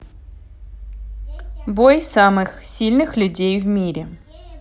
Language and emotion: Russian, neutral